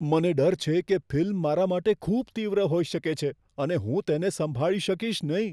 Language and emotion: Gujarati, fearful